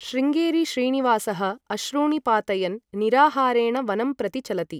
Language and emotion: Sanskrit, neutral